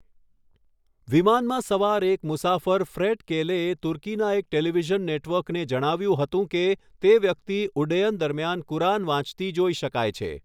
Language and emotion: Gujarati, neutral